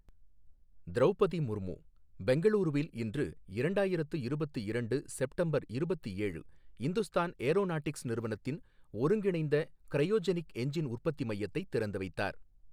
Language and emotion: Tamil, neutral